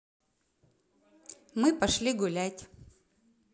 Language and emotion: Russian, positive